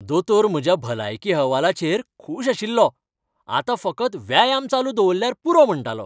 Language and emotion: Goan Konkani, happy